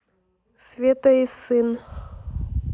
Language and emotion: Russian, neutral